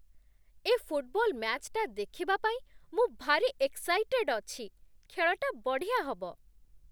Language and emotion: Odia, happy